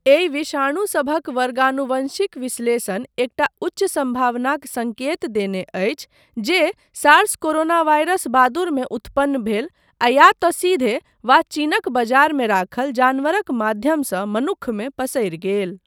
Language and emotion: Maithili, neutral